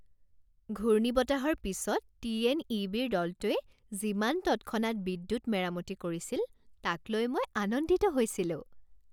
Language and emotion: Assamese, happy